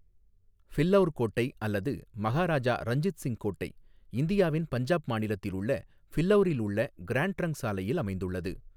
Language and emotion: Tamil, neutral